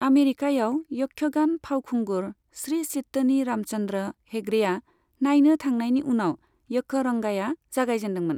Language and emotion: Bodo, neutral